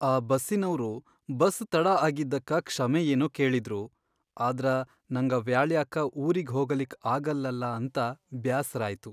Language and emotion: Kannada, sad